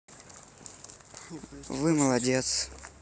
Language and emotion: Russian, neutral